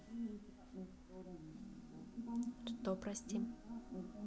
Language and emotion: Russian, neutral